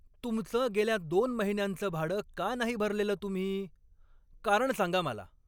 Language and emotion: Marathi, angry